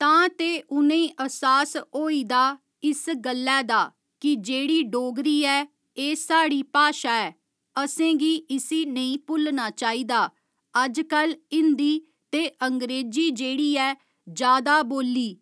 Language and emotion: Dogri, neutral